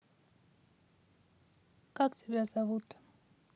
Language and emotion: Russian, neutral